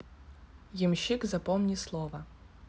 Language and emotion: Russian, neutral